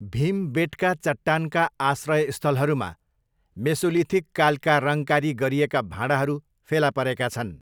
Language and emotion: Nepali, neutral